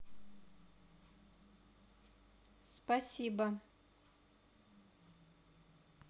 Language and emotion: Russian, neutral